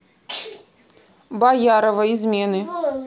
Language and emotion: Russian, neutral